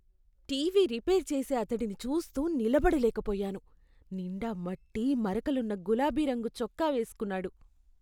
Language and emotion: Telugu, disgusted